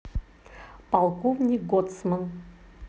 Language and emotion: Russian, neutral